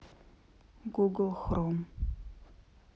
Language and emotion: Russian, neutral